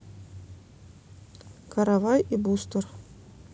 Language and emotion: Russian, neutral